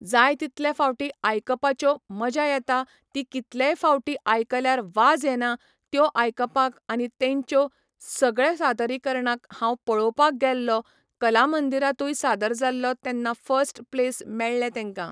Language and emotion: Goan Konkani, neutral